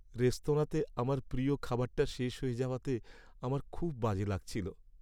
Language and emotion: Bengali, sad